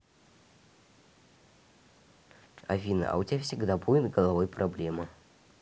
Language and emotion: Russian, neutral